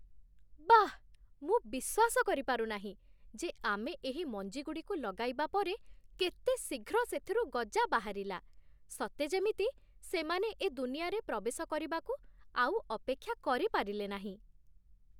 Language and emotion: Odia, surprised